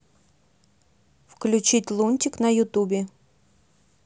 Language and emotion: Russian, neutral